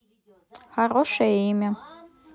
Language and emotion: Russian, neutral